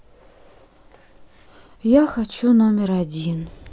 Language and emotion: Russian, sad